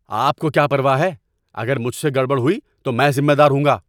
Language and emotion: Urdu, angry